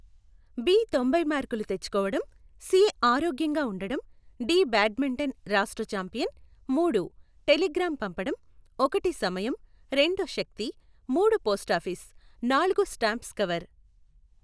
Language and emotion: Telugu, neutral